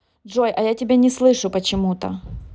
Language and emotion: Russian, neutral